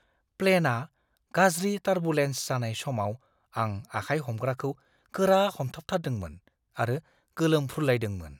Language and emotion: Bodo, fearful